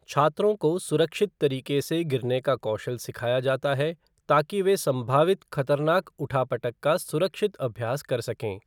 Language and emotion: Hindi, neutral